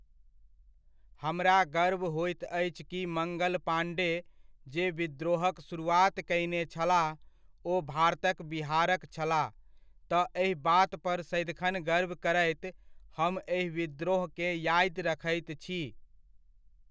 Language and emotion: Maithili, neutral